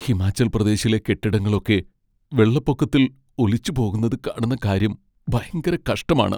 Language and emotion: Malayalam, sad